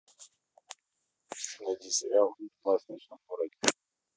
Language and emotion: Russian, neutral